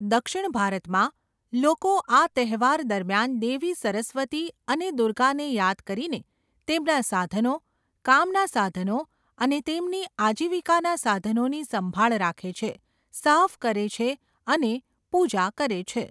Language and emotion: Gujarati, neutral